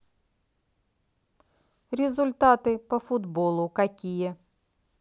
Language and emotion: Russian, neutral